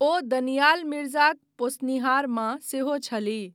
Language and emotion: Maithili, neutral